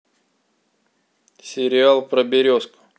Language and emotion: Russian, neutral